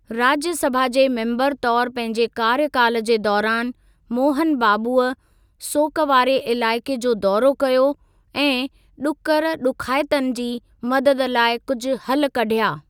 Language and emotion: Sindhi, neutral